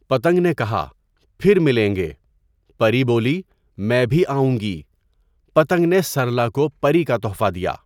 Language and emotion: Urdu, neutral